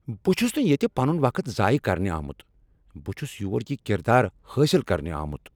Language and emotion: Kashmiri, angry